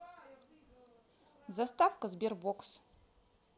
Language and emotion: Russian, neutral